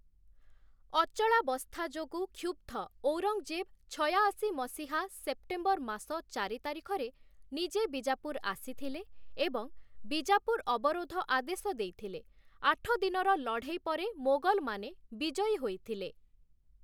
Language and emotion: Odia, neutral